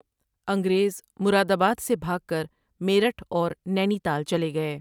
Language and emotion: Urdu, neutral